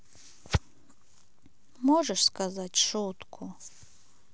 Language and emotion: Russian, neutral